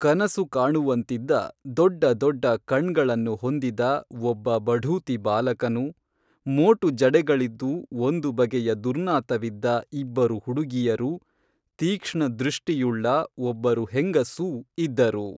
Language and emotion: Kannada, neutral